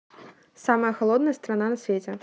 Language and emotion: Russian, neutral